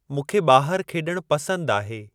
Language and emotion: Sindhi, neutral